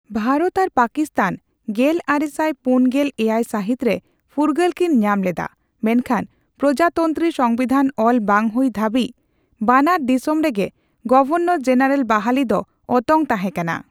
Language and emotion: Santali, neutral